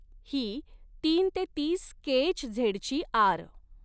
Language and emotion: Marathi, neutral